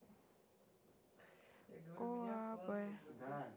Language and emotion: Russian, neutral